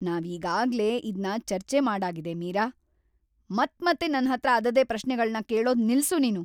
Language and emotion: Kannada, angry